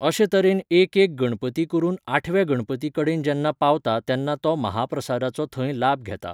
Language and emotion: Goan Konkani, neutral